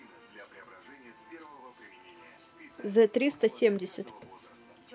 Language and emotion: Russian, neutral